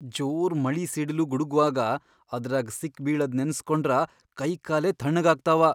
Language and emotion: Kannada, fearful